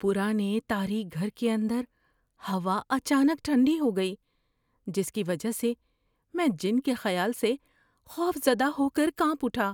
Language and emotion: Urdu, fearful